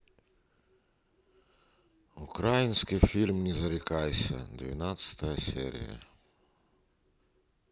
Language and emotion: Russian, sad